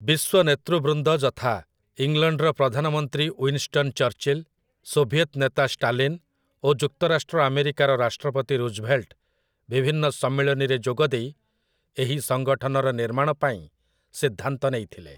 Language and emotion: Odia, neutral